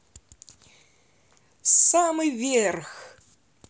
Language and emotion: Russian, positive